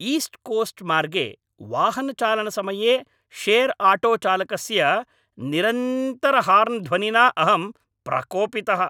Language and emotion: Sanskrit, angry